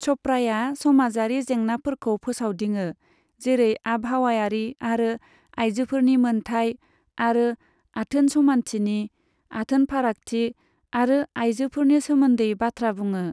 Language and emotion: Bodo, neutral